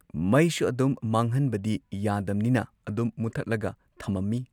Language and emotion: Manipuri, neutral